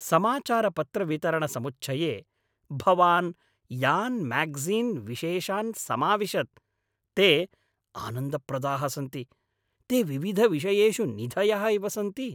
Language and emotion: Sanskrit, happy